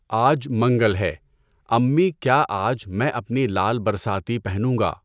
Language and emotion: Urdu, neutral